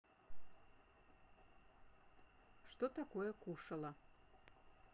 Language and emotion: Russian, neutral